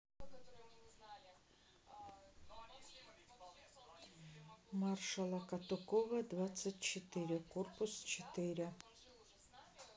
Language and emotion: Russian, neutral